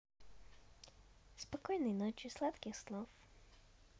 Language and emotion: Russian, positive